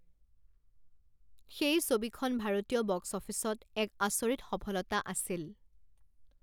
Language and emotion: Assamese, neutral